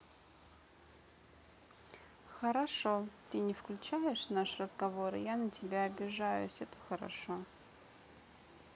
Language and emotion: Russian, neutral